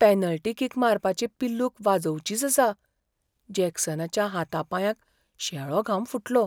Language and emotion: Goan Konkani, fearful